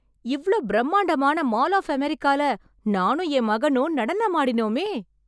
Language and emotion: Tamil, happy